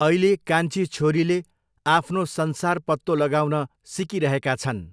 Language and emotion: Nepali, neutral